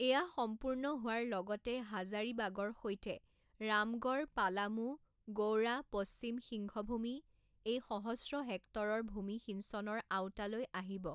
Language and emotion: Assamese, neutral